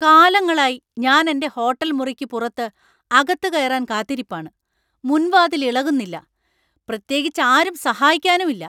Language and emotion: Malayalam, angry